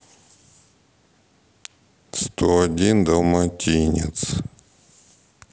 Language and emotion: Russian, sad